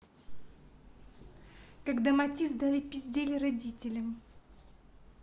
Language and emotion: Russian, neutral